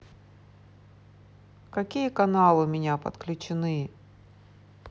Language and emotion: Russian, neutral